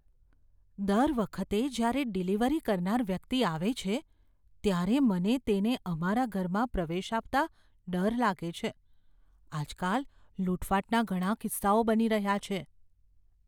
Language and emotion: Gujarati, fearful